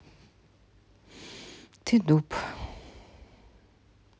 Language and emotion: Russian, neutral